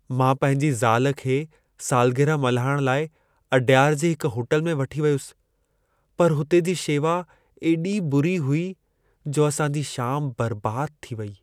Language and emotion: Sindhi, sad